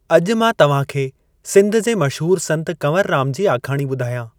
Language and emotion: Sindhi, neutral